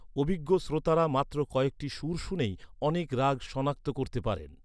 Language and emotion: Bengali, neutral